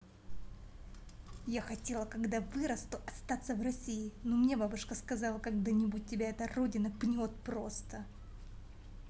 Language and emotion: Russian, angry